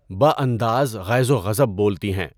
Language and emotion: Urdu, neutral